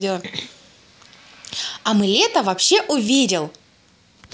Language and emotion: Russian, positive